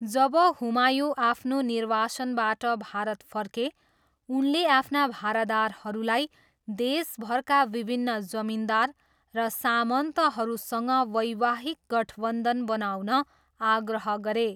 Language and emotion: Nepali, neutral